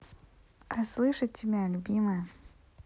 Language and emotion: Russian, neutral